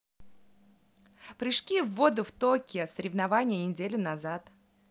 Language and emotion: Russian, positive